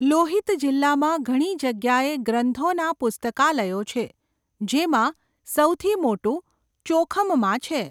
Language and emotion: Gujarati, neutral